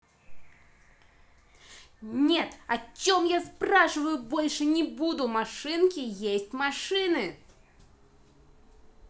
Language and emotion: Russian, angry